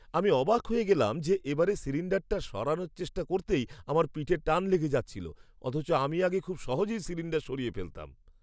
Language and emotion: Bengali, surprised